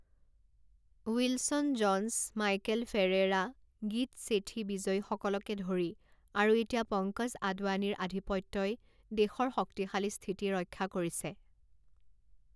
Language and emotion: Assamese, neutral